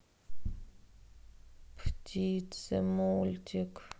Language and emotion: Russian, sad